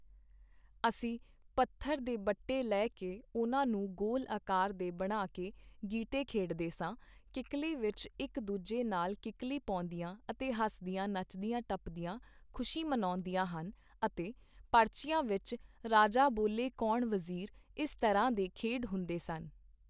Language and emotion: Punjabi, neutral